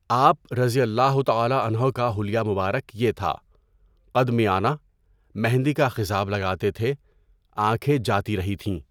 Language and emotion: Urdu, neutral